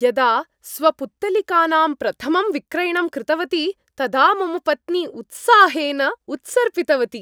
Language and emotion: Sanskrit, happy